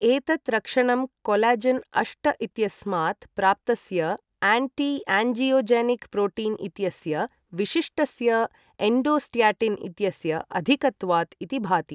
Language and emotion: Sanskrit, neutral